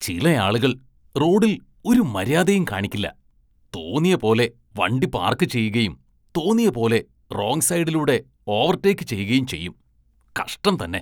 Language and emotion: Malayalam, disgusted